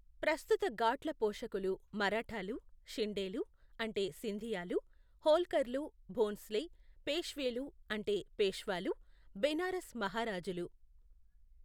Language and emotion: Telugu, neutral